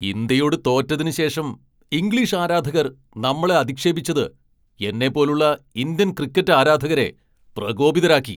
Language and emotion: Malayalam, angry